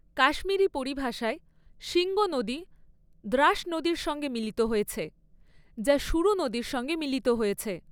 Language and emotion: Bengali, neutral